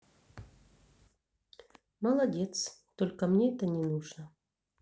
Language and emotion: Russian, neutral